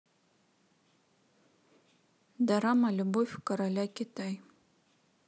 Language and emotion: Russian, neutral